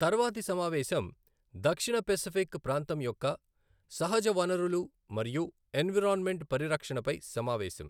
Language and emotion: Telugu, neutral